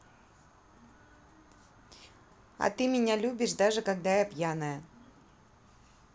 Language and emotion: Russian, neutral